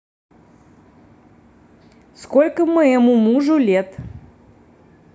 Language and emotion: Russian, neutral